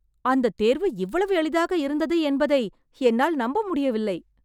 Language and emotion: Tamil, surprised